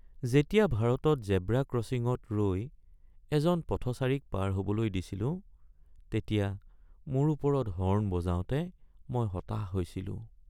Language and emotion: Assamese, sad